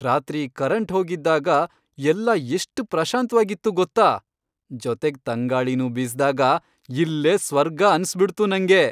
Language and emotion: Kannada, happy